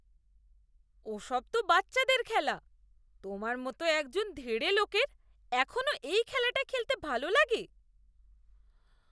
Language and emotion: Bengali, disgusted